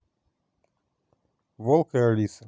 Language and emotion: Russian, neutral